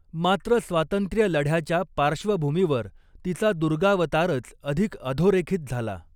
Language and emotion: Marathi, neutral